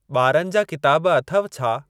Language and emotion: Sindhi, neutral